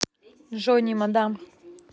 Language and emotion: Russian, neutral